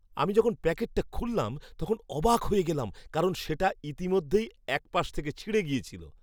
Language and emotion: Bengali, surprised